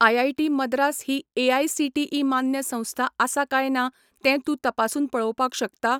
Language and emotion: Goan Konkani, neutral